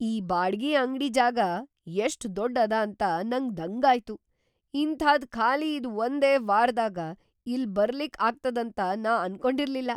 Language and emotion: Kannada, surprised